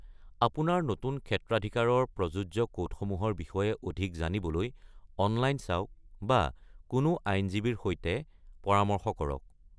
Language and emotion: Assamese, neutral